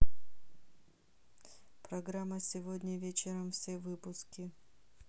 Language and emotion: Russian, neutral